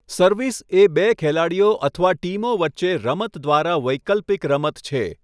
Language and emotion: Gujarati, neutral